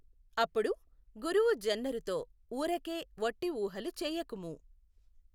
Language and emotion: Telugu, neutral